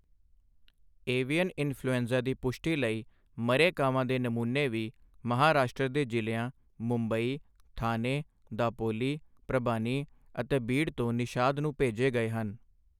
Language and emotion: Punjabi, neutral